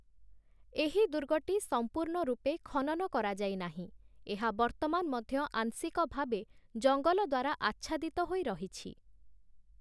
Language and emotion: Odia, neutral